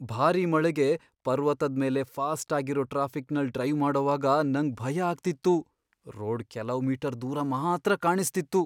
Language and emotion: Kannada, fearful